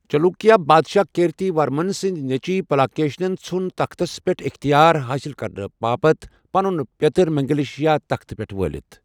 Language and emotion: Kashmiri, neutral